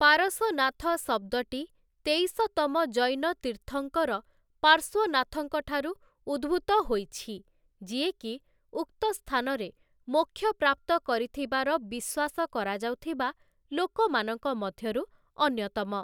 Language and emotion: Odia, neutral